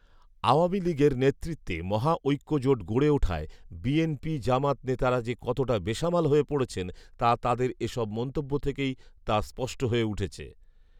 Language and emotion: Bengali, neutral